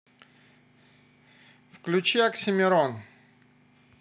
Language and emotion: Russian, positive